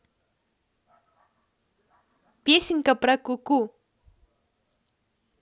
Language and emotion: Russian, positive